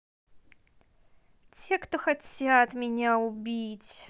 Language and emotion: Russian, neutral